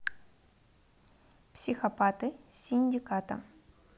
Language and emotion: Russian, neutral